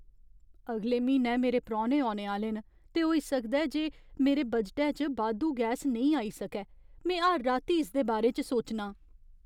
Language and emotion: Dogri, fearful